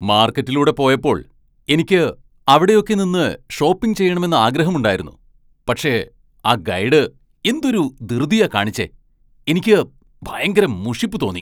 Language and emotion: Malayalam, angry